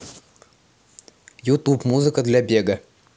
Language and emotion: Russian, neutral